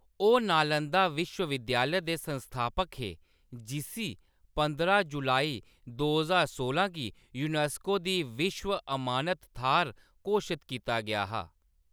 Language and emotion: Dogri, neutral